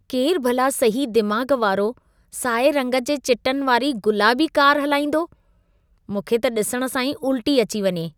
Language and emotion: Sindhi, disgusted